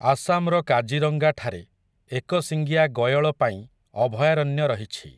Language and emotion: Odia, neutral